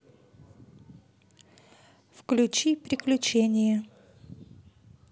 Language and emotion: Russian, neutral